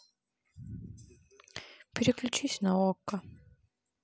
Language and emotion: Russian, sad